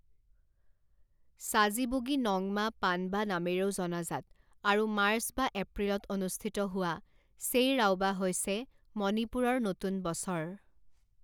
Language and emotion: Assamese, neutral